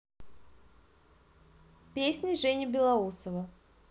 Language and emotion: Russian, positive